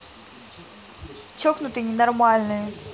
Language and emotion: Russian, angry